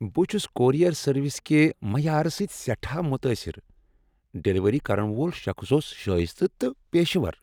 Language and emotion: Kashmiri, happy